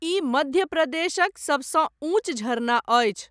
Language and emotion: Maithili, neutral